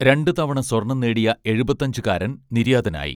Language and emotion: Malayalam, neutral